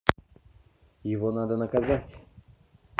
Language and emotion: Russian, neutral